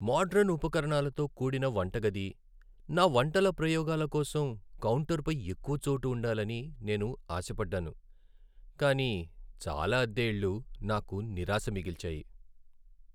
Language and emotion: Telugu, sad